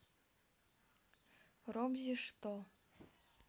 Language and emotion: Russian, neutral